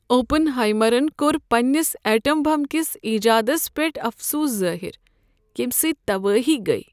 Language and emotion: Kashmiri, sad